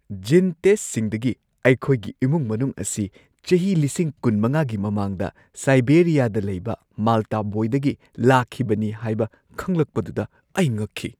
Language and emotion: Manipuri, surprised